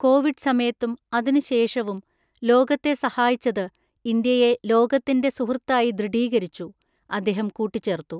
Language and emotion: Malayalam, neutral